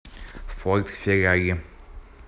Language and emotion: Russian, neutral